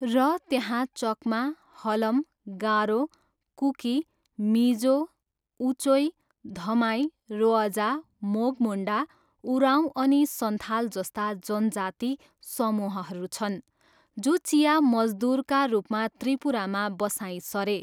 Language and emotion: Nepali, neutral